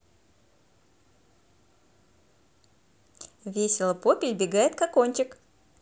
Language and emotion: Russian, positive